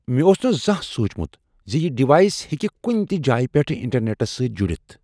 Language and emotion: Kashmiri, surprised